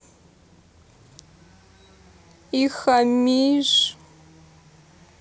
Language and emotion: Russian, sad